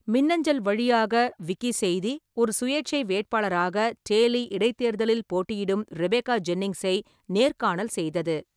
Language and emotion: Tamil, neutral